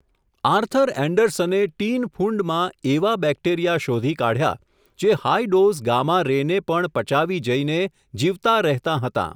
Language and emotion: Gujarati, neutral